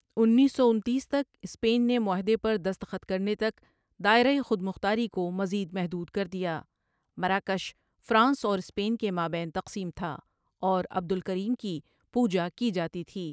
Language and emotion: Urdu, neutral